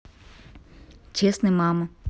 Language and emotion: Russian, neutral